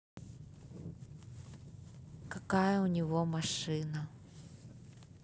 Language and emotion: Russian, neutral